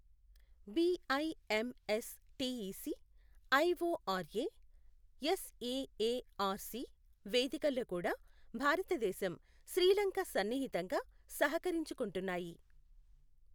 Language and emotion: Telugu, neutral